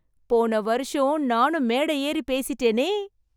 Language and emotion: Tamil, happy